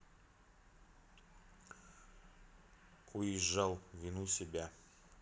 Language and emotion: Russian, neutral